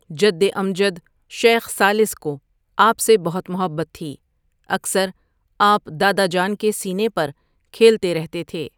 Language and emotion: Urdu, neutral